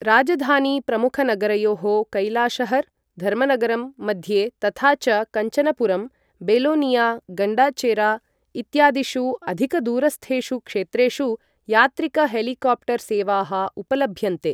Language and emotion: Sanskrit, neutral